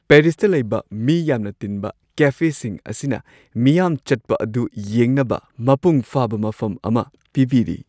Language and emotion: Manipuri, happy